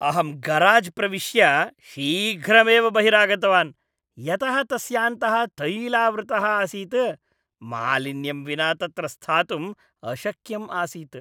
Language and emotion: Sanskrit, disgusted